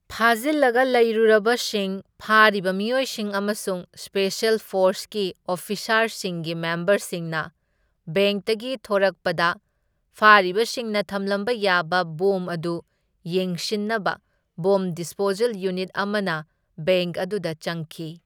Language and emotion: Manipuri, neutral